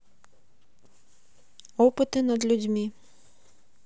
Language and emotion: Russian, neutral